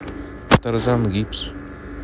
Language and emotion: Russian, neutral